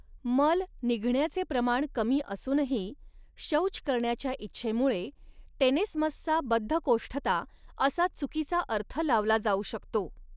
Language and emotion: Marathi, neutral